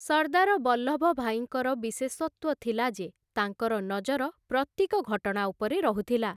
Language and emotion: Odia, neutral